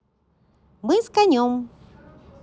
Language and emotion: Russian, positive